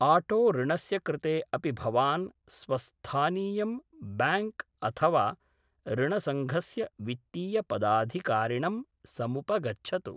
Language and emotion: Sanskrit, neutral